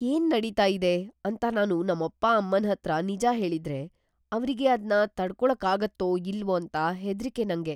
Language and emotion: Kannada, fearful